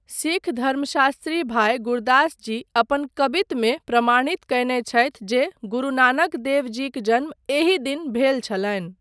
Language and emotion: Maithili, neutral